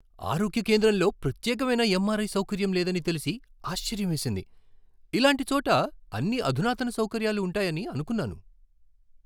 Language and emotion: Telugu, surprised